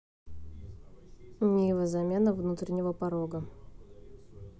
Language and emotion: Russian, neutral